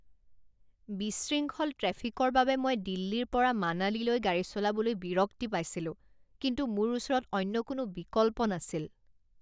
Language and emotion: Assamese, disgusted